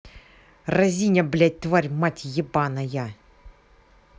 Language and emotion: Russian, angry